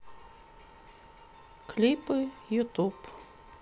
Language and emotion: Russian, sad